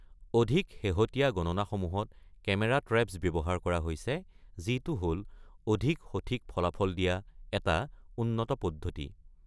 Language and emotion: Assamese, neutral